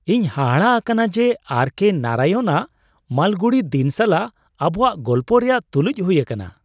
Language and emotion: Santali, surprised